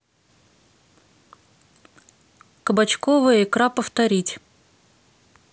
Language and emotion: Russian, neutral